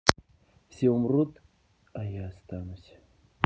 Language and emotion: Russian, sad